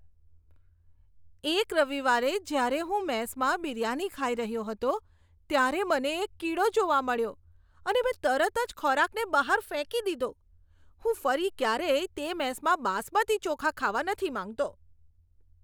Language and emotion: Gujarati, disgusted